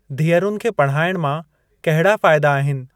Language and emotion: Sindhi, neutral